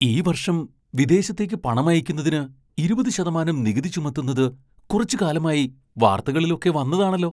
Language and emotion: Malayalam, surprised